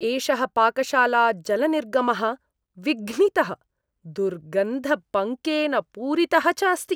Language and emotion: Sanskrit, disgusted